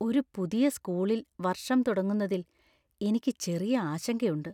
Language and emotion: Malayalam, fearful